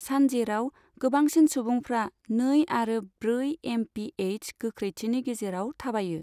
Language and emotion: Bodo, neutral